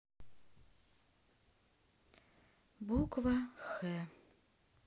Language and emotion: Russian, sad